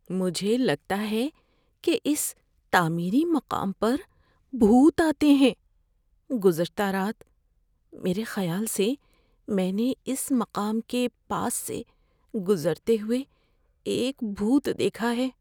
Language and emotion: Urdu, fearful